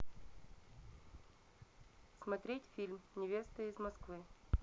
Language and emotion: Russian, neutral